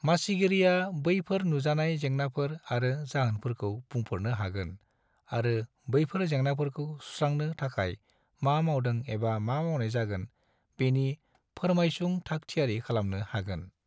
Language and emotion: Bodo, neutral